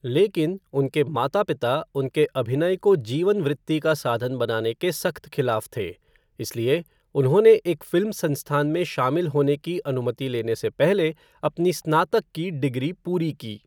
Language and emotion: Hindi, neutral